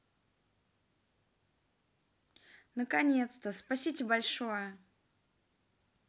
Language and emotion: Russian, positive